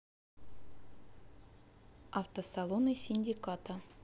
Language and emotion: Russian, neutral